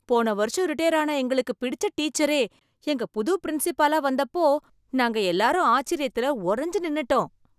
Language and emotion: Tamil, surprised